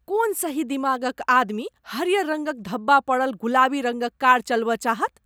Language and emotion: Maithili, disgusted